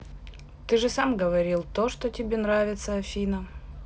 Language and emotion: Russian, neutral